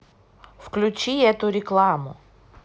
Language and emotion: Russian, neutral